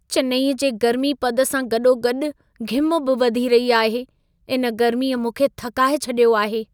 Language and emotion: Sindhi, sad